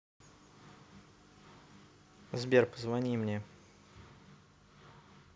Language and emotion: Russian, neutral